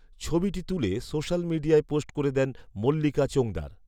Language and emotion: Bengali, neutral